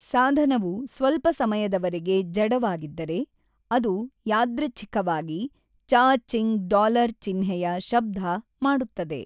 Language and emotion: Kannada, neutral